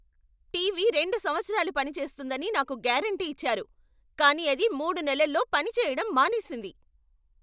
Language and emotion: Telugu, angry